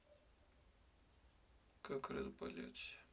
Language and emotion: Russian, sad